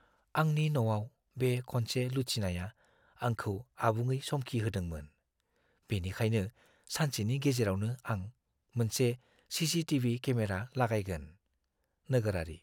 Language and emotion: Bodo, fearful